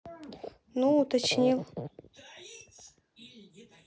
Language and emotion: Russian, neutral